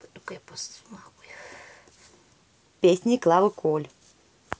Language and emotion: Russian, neutral